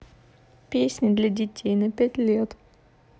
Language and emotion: Russian, sad